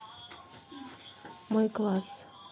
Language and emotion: Russian, neutral